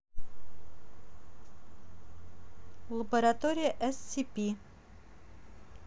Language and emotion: Russian, neutral